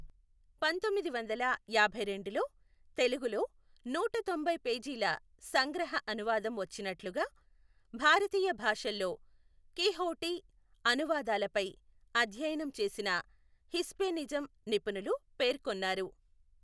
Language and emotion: Telugu, neutral